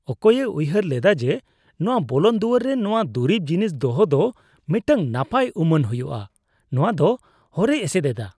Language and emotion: Santali, disgusted